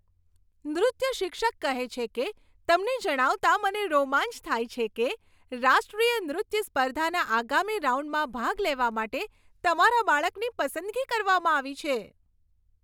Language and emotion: Gujarati, happy